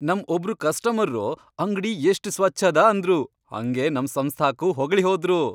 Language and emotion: Kannada, happy